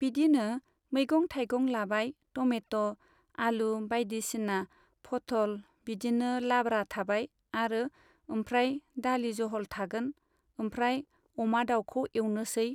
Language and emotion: Bodo, neutral